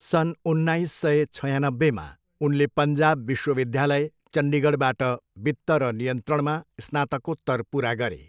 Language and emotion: Nepali, neutral